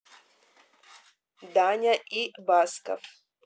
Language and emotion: Russian, neutral